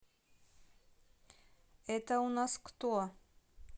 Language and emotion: Russian, neutral